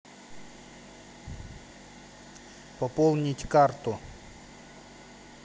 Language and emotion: Russian, neutral